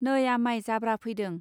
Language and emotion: Bodo, neutral